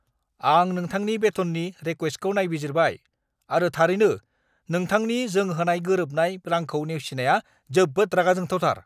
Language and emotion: Bodo, angry